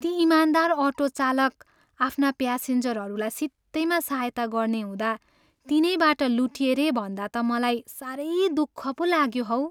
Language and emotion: Nepali, sad